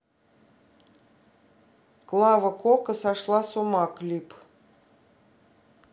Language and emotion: Russian, neutral